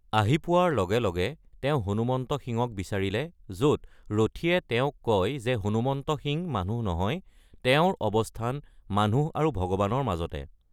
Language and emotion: Assamese, neutral